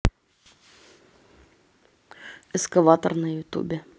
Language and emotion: Russian, neutral